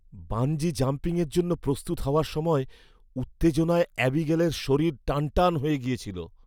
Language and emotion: Bengali, fearful